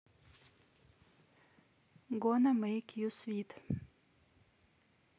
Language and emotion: Russian, neutral